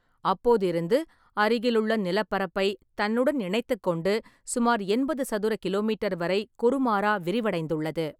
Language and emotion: Tamil, neutral